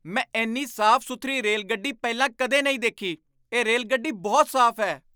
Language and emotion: Punjabi, surprised